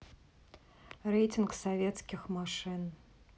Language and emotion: Russian, neutral